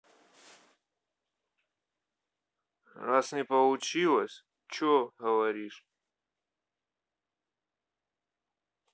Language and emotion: Russian, neutral